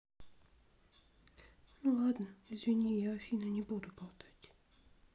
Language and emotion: Russian, sad